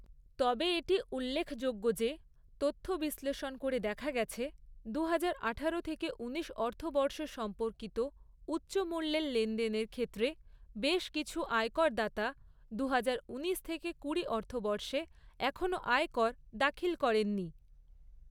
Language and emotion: Bengali, neutral